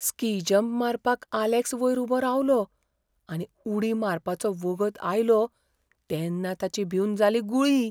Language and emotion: Goan Konkani, fearful